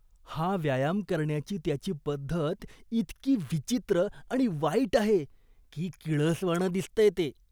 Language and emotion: Marathi, disgusted